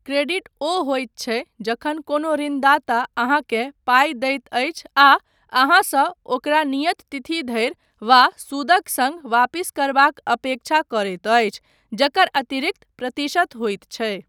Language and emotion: Maithili, neutral